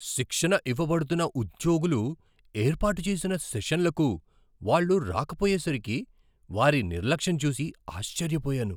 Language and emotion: Telugu, surprised